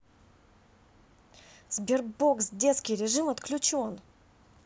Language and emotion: Russian, angry